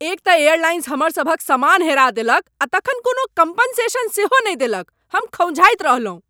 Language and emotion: Maithili, angry